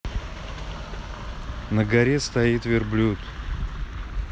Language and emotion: Russian, neutral